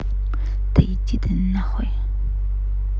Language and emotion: Russian, angry